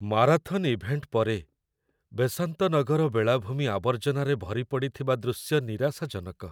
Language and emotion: Odia, sad